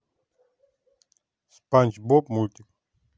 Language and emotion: Russian, neutral